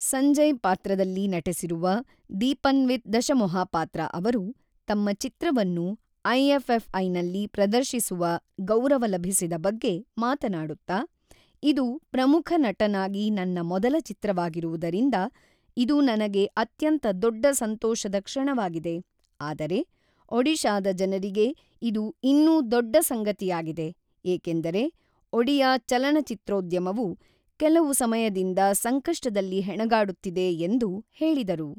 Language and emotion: Kannada, neutral